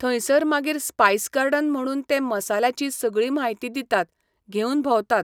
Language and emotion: Goan Konkani, neutral